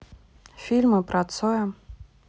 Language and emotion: Russian, neutral